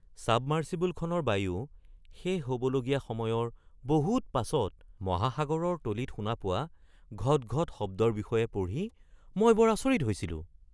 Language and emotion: Assamese, surprised